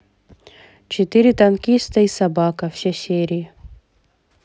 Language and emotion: Russian, neutral